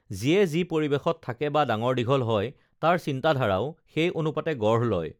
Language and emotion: Assamese, neutral